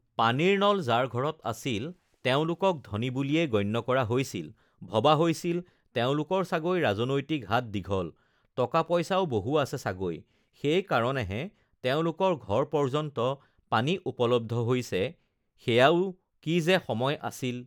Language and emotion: Assamese, neutral